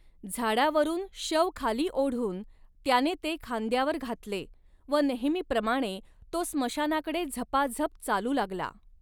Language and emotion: Marathi, neutral